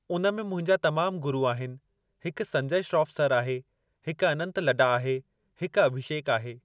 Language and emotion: Sindhi, neutral